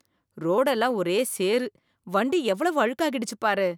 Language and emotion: Tamil, disgusted